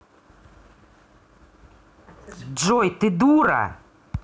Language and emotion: Russian, angry